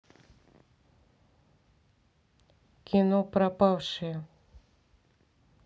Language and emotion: Russian, neutral